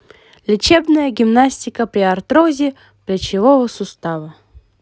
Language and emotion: Russian, positive